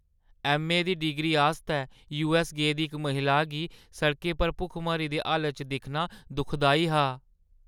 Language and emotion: Dogri, sad